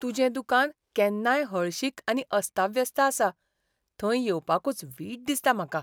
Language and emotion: Goan Konkani, disgusted